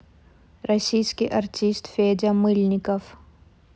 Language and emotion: Russian, neutral